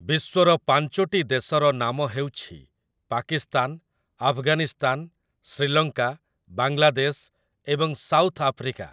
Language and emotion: Odia, neutral